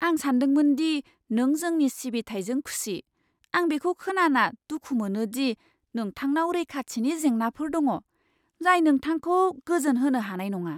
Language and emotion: Bodo, surprised